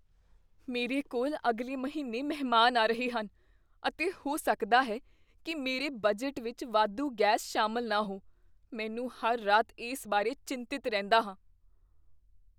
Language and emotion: Punjabi, fearful